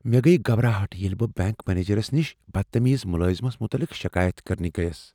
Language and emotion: Kashmiri, fearful